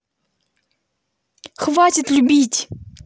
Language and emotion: Russian, angry